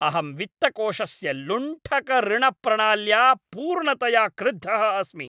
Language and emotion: Sanskrit, angry